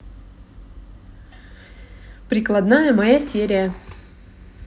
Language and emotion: Russian, neutral